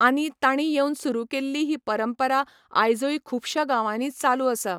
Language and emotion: Goan Konkani, neutral